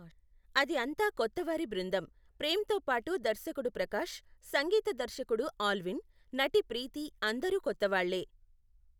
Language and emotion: Telugu, neutral